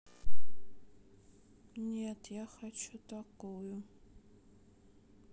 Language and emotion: Russian, sad